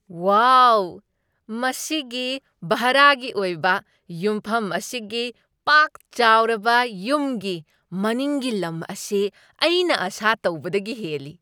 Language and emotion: Manipuri, surprised